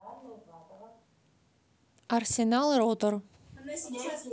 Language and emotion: Russian, neutral